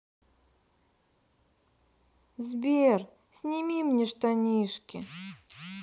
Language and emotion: Russian, sad